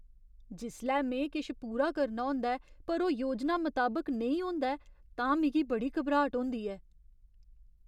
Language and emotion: Dogri, fearful